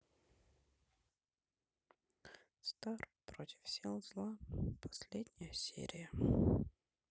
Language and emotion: Russian, sad